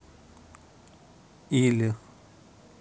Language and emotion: Russian, neutral